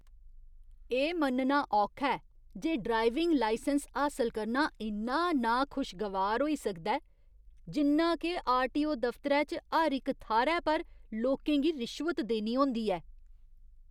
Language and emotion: Dogri, disgusted